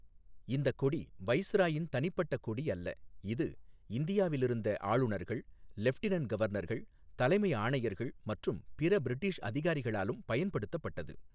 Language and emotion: Tamil, neutral